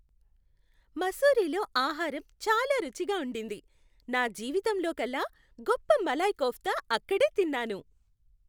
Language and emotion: Telugu, happy